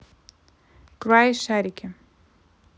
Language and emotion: Russian, neutral